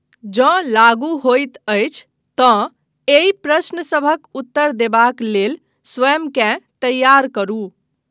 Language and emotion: Maithili, neutral